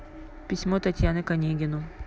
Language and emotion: Russian, neutral